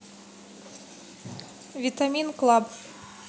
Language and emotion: Russian, neutral